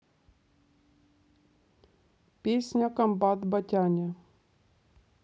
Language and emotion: Russian, neutral